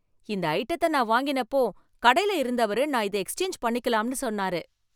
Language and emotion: Tamil, happy